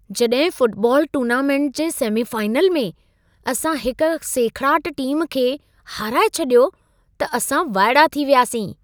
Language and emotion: Sindhi, surprised